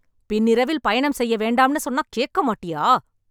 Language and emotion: Tamil, angry